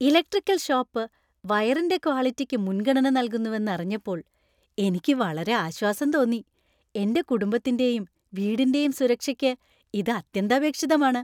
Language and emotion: Malayalam, happy